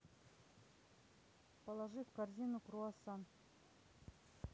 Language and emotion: Russian, neutral